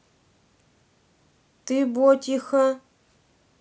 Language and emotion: Russian, neutral